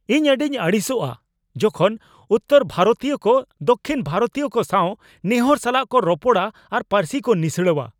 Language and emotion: Santali, angry